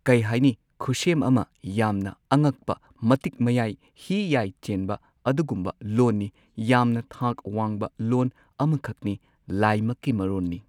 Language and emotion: Manipuri, neutral